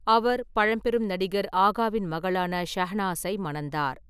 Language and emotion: Tamil, neutral